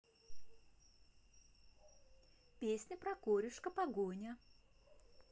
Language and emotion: Russian, positive